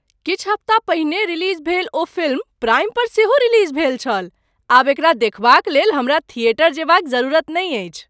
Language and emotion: Maithili, surprised